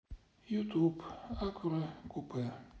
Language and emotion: Russian, sad